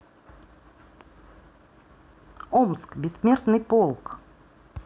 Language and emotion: Russian, neutral